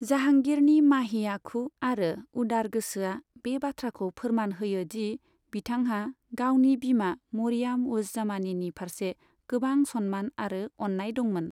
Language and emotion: Bodo, neutral